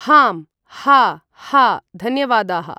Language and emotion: Sanskrit, neutral